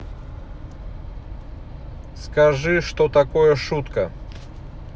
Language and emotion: Russian, neutral